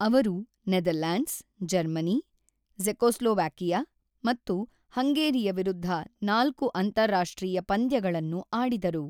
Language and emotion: Kannada, neutral